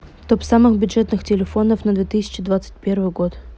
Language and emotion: Russian, neutral